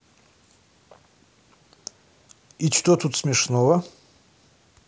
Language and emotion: Russian, neutral